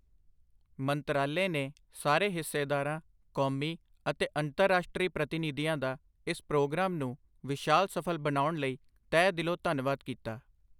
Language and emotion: Punjabi, neutral